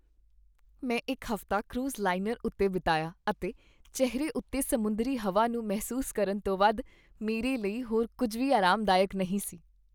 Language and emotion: Punjabi, happy